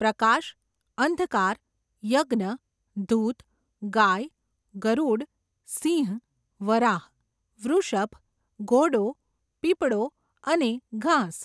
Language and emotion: Gujarati, neutral